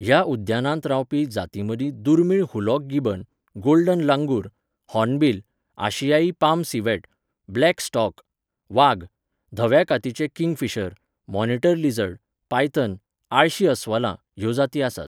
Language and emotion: Goan Konkani, neutral